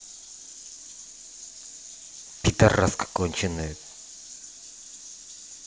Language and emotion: Russian, angry